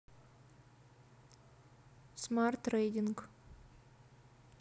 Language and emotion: Russian, neutral